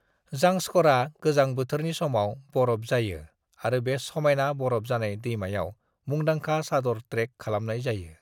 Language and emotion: Bodo, neutral